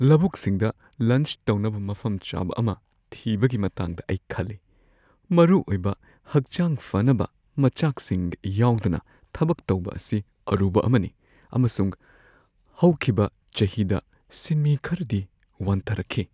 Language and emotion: Manipuri, fearful